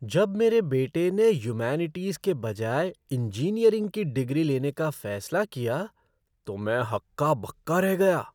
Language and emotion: Hindi, surprised